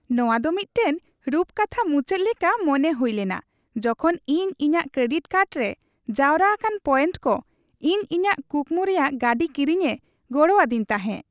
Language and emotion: Santali, happy